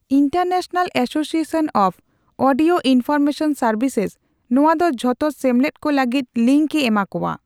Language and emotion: Santali, neutral